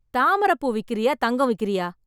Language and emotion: Tamil, angry